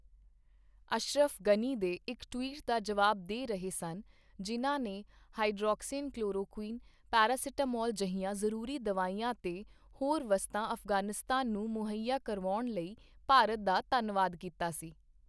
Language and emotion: Punjabi, neutral